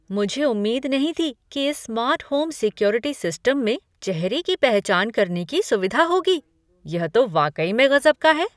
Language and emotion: Hindi, surprised